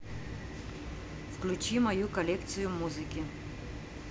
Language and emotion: Russian, neutral